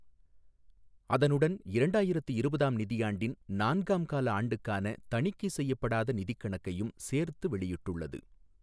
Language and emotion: Tamil, neutral